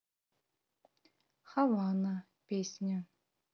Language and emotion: Russian, neutral